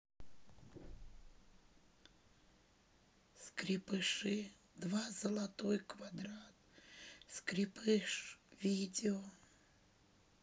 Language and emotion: Russian, sad